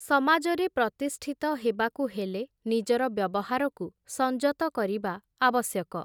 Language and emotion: Odia, neutral